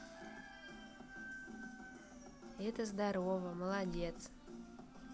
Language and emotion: Russian, positive